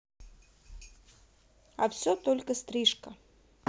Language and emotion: Russian, neutral